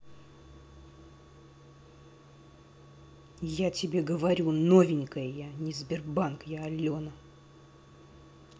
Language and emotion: Russian, angry